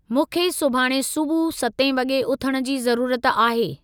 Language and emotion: Sindhi, neutral